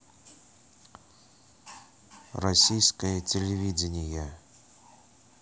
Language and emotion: Russian, neutral